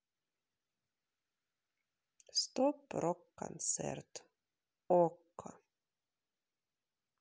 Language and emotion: Russian, sad